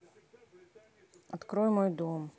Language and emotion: Russian, neutral